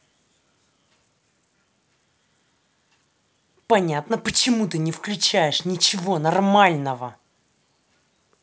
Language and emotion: Russian, angry